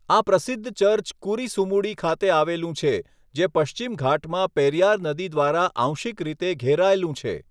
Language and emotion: Gujarati, neutral